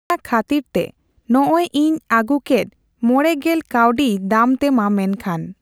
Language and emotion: Santali, neutral